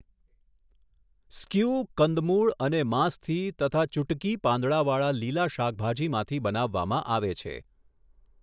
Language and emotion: Gujarati, neutral